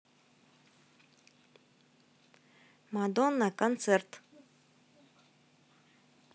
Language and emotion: Russian, neutral